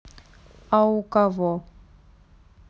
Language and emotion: Russian, neutral